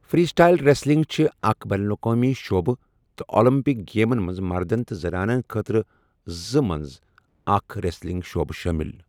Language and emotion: Kashmiri, neutral